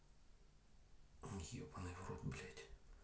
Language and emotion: Russian, neutral